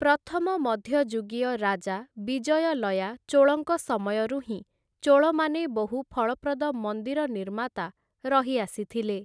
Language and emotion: Odia, neutral